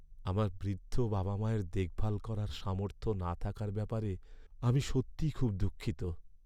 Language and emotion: Bengali, sad